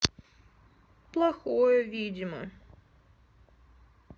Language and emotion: Russian, sad